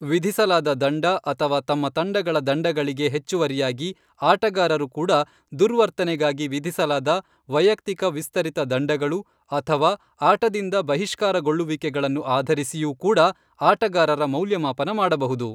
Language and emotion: Kannada, neutral